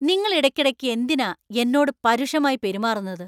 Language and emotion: Malayalam, angry